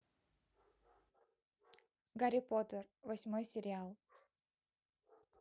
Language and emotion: Russian, neutral